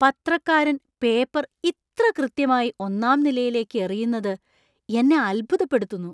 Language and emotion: Malayalam, surprised